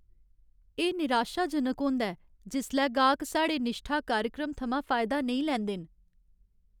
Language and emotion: Dogri, sad